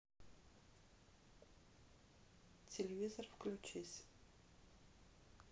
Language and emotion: Russian, neutral